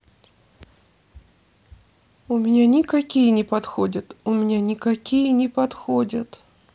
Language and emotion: Russian, sad